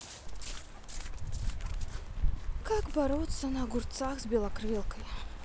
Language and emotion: Russian, sad